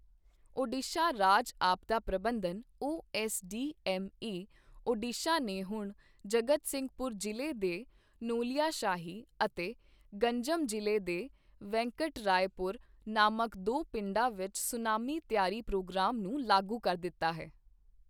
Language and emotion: Punjabi, neutral